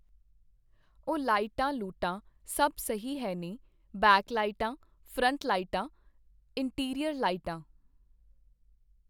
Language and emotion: Punjabi, neutral